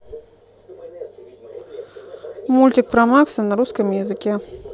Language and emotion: Russian, neutral